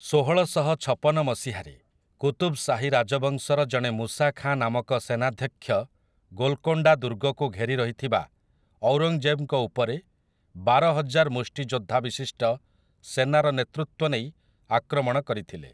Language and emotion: Odia, neutral